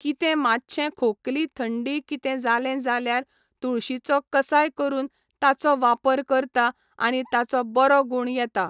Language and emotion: Goan Konkani, neutral